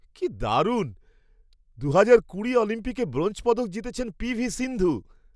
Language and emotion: Bengali, surprised